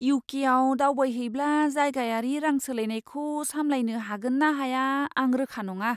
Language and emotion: Bodo, fearful